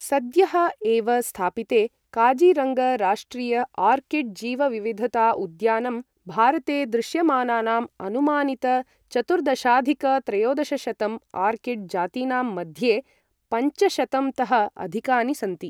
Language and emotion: Sanskrit, neutral